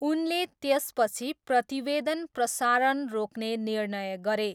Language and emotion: Nepali, neutral